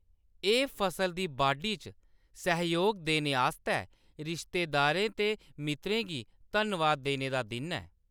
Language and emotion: Dogri, neutral